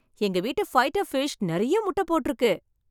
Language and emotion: Tamil, happy